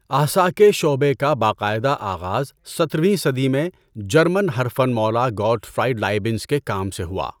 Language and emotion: Urdu, neutral